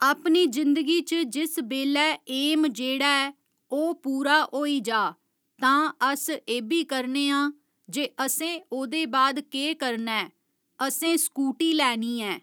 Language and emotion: Dogri, neutral